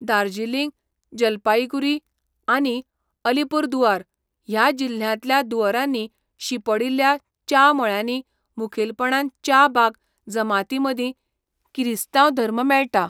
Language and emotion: Goan Konkani, neutral